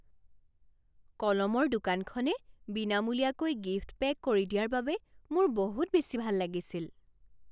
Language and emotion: Assamese, surprised